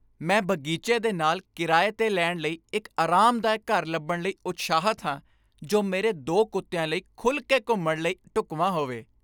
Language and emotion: Punjabi, happy